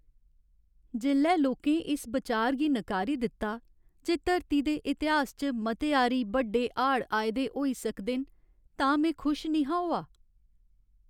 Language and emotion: Dogri, sad